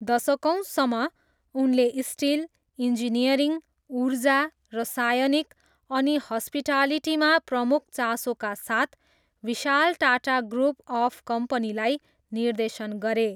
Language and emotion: Nepali, neutral